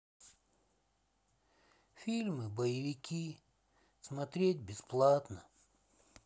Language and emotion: Russian, sad